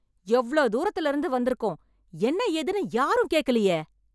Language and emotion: Tamil, angry